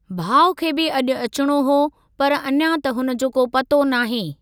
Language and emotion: Sindhi, neutral